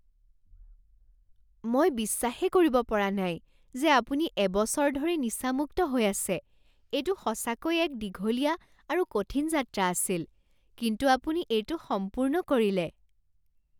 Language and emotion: Assamese, surprised